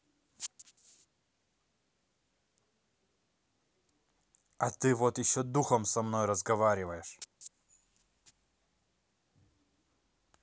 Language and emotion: Russian, angry